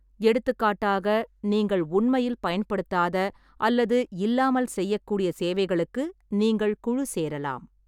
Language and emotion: Tamil, neutral